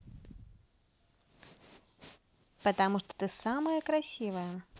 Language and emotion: Russian, positive